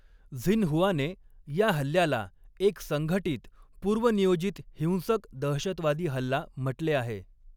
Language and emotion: Marathi, neutral